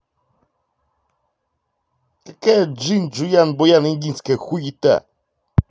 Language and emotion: Russian, angry